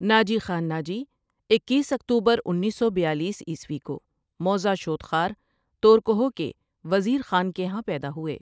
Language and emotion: Urdu, neutral